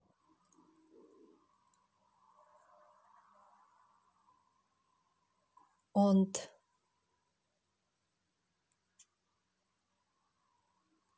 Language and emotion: Russian, neutral